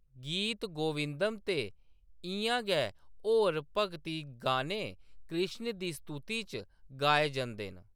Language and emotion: Dogri, neutral